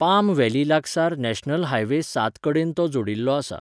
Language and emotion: Goan Konkani, neutral